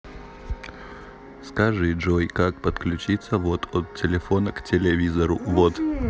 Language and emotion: Russian, neutral